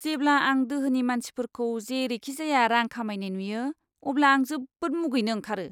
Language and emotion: Bodo, disgusted